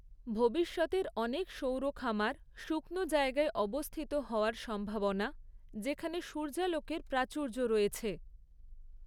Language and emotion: Bengali, neutral